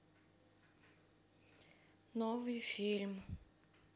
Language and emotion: Russian, sad